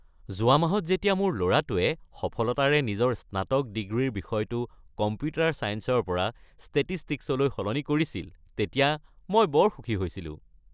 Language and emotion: Assamese, happy